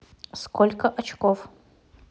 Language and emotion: Russian, neutral